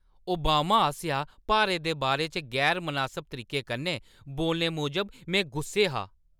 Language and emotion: Dogri, angry